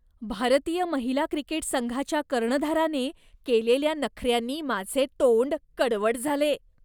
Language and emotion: Marathi, disgusted